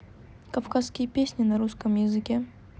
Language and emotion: Russian, neutral